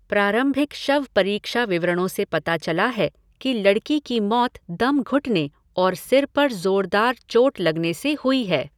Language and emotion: Hindi, neutral